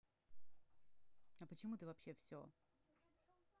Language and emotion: Russian, neutral